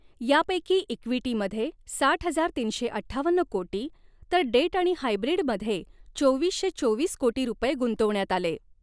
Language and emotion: Marathi, neutral